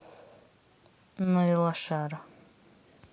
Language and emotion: Russian, neutral